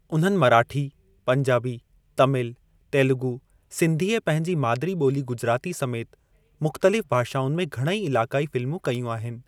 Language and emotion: Sindhi, neutral